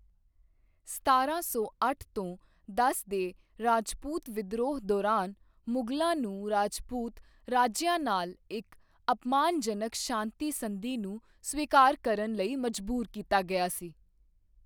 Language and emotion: Punjabi, neutral